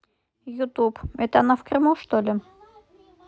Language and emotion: Russian, neutral